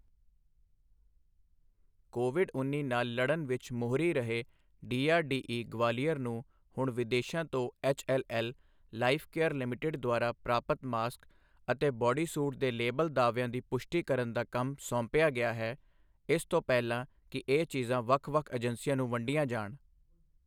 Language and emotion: Punjabi, neutral